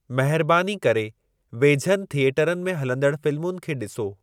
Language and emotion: Sindhi, neutral